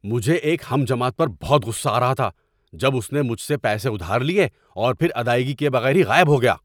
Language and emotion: Urdu, angry